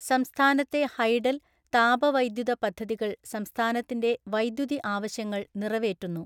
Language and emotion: Malayalam, neutral